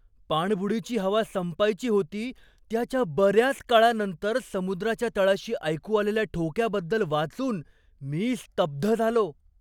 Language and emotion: Marathi, surprised